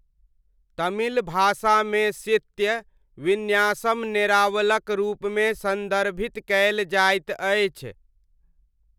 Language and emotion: Maithili, neutral